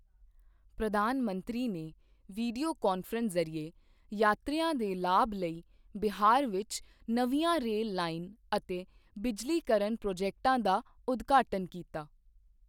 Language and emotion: Punjabi, neutral